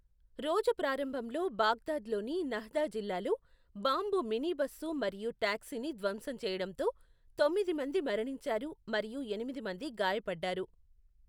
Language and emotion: Telugu, neutral